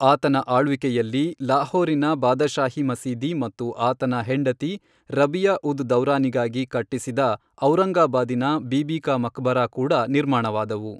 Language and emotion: Kannada, neutral